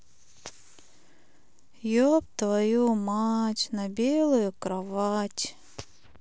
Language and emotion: Russian, sad